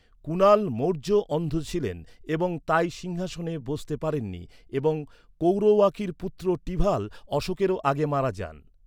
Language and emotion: Bengali, neutral